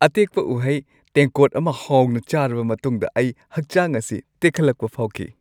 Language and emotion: Manipuri, happy